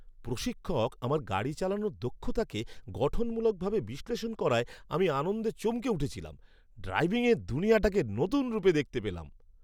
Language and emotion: Bengali, surprised